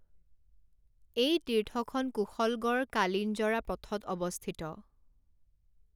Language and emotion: Assamese, neutral